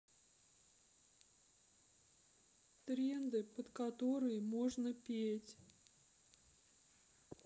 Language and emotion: Russian, sad